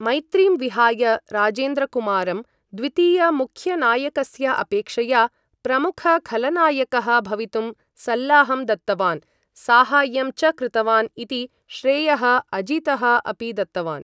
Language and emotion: Sanskrit, neutral